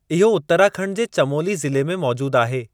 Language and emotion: Sindhi, neutral